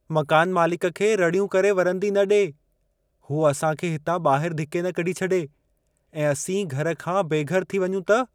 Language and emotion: Sindhi, fearful